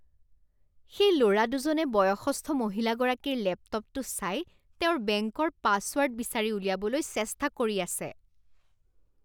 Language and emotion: Assamese, disgusted